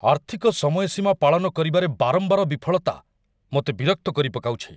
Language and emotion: Odia, angry